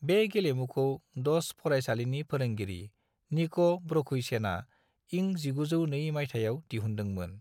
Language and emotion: Bodo, neutral